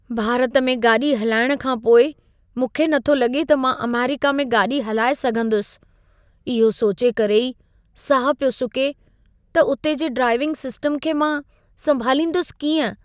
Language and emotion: Sindhi, fearful